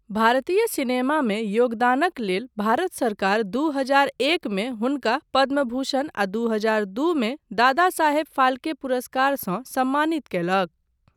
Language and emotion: Maithili, neutral